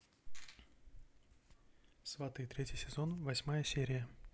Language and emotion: Russian, neutral